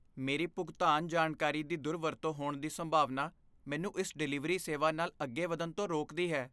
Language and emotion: Punjabi, fearful